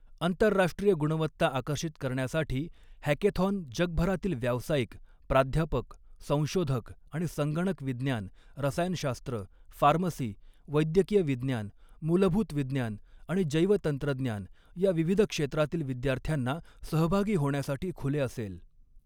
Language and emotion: Marathi, neutral